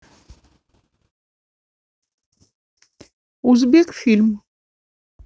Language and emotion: Russian, neutral